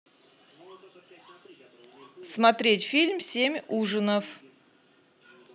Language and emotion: Russian, neutral